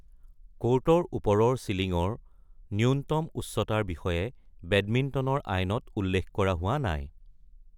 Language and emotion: Assamese, neutral